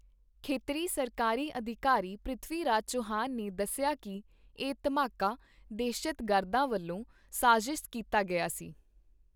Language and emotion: Punjabi, neutral